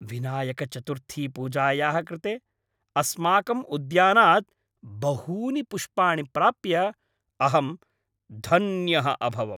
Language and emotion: Sanskrit, happy